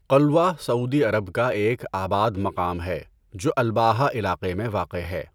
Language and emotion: Urdu, neutral